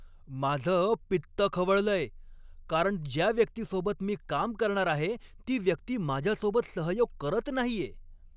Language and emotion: Marathi, angry